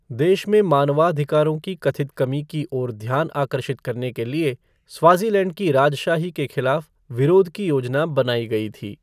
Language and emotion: Hindi, neutral